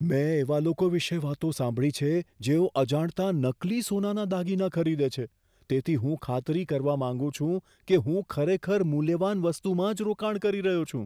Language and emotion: Gujarati, fearful